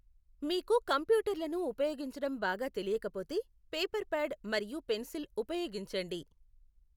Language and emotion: Telugu, neutral